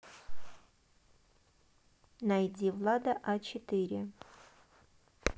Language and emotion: Russian, neutral